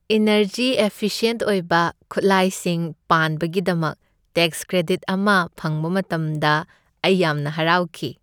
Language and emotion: Manipuri, happy